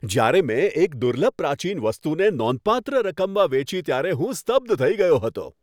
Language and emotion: Gujarati, happy